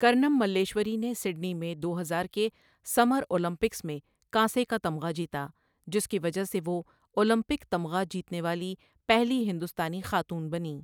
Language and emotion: Urdu, neutral